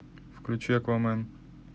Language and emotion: Russian, neutral